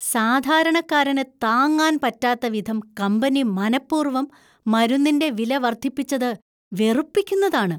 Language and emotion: Malayalam, disgusted